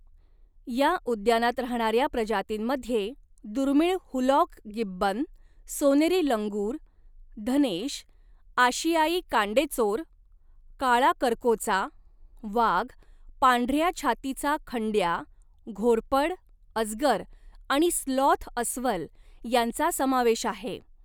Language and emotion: Marathi, neutral